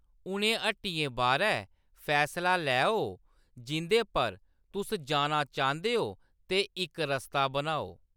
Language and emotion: Dogri, neutral